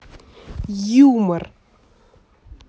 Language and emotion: Russian, angry